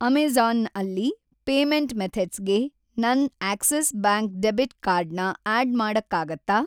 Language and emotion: Kannada, neutral